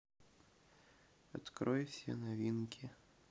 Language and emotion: Russian, neutral